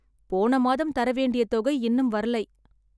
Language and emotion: Tamil, sad